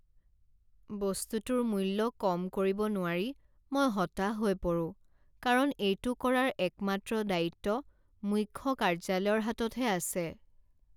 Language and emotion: Assamese, sad